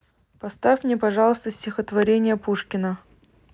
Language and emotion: Russian, neutral